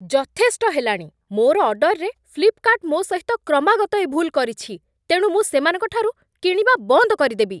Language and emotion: Odia, angry